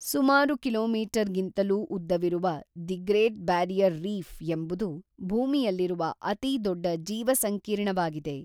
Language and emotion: Kannada, neutral